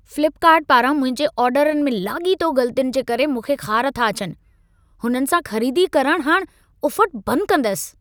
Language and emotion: Sindhi, angry